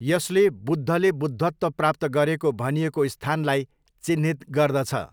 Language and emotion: Nepali, neutral